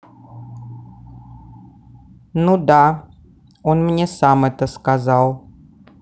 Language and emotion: Russian, neutral